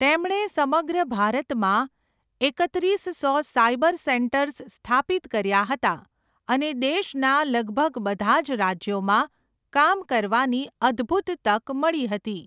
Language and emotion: Gujarati, neutral